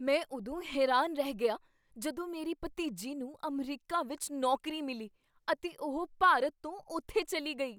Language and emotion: Punjabi, surprised